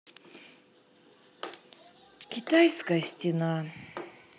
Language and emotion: Russian, sad